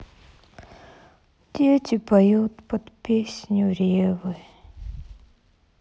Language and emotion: Russian, sad